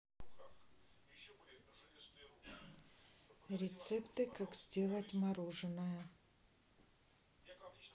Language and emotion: Russian, neutral